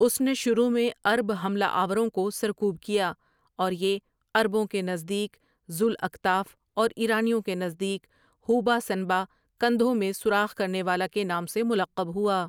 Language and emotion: Urdu, neutral